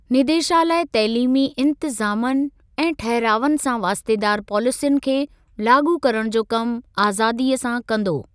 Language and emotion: Sindhi, neutral